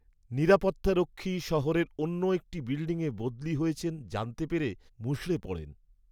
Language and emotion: Bengali, sad